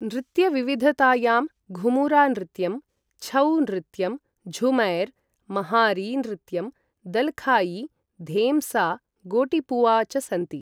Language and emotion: Sanskrit, neutral